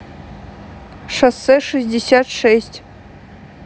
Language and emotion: Russian, neutral